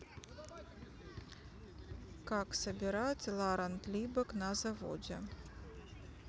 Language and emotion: Russian, neutral